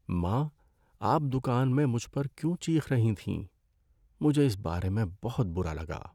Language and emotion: Urdu, sad